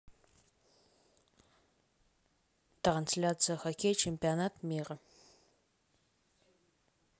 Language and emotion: Russian, neutral